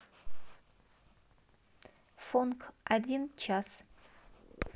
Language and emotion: Russian, neutral